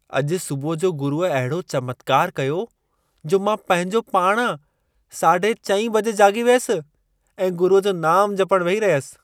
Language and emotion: Sindhi, surprised